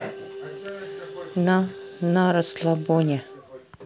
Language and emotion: Russian, neutral